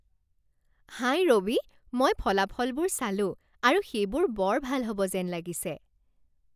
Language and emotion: Assamese, happy